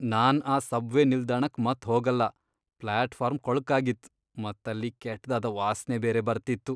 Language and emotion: Kannada, disgusted